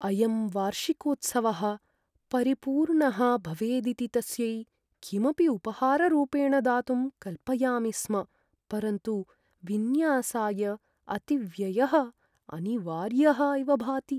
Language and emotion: Sanskrit, sad